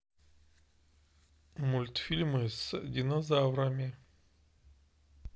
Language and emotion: Russian, neutral